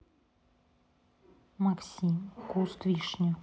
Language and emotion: Russian, neutral